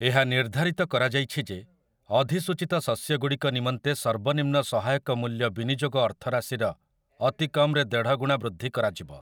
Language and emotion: Odia, neutral